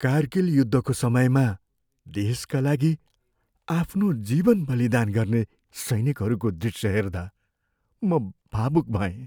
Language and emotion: Nepali, sad